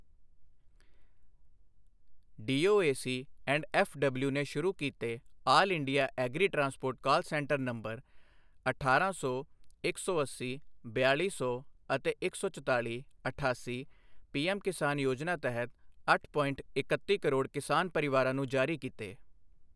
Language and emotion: Punjabi, neutral